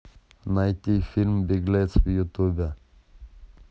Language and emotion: Russian, neutral